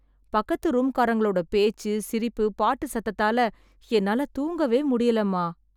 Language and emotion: Tamil, sad